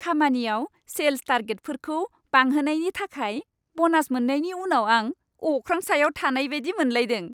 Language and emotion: Bodo, happy